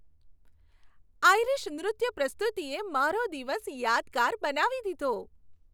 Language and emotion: Gujarati, happy